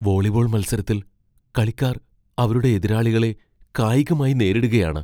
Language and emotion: Malayalam, fearful